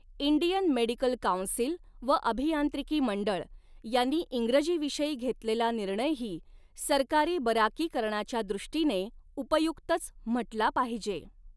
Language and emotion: Marathi, neutral